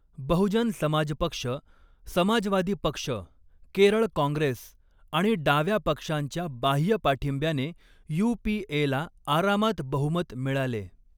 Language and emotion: Marathi, neutral